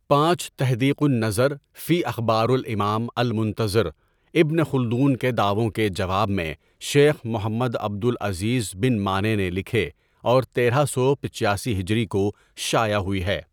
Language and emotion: Urdu, neutral